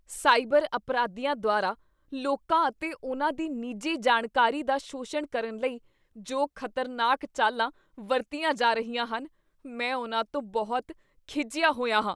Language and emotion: Punjabi, disgusted